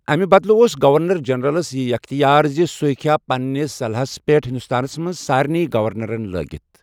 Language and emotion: Kashmiri, neutral